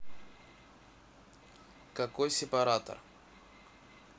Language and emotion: Russian, neutral